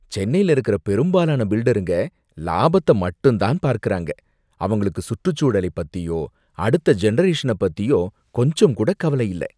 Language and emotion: Tamil, disgusted